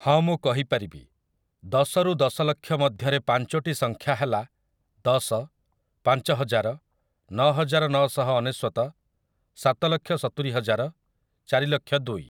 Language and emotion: Odia, neutral